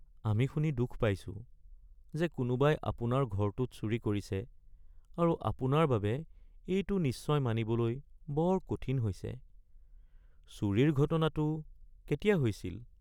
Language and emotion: Assamese, sad